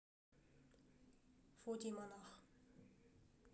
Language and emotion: Russian, neutral